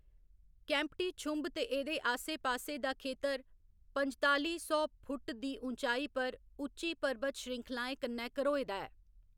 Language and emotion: Dogri, neutral